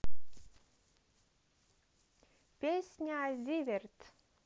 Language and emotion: Russian, positive